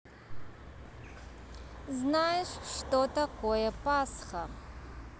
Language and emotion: Russian, neutral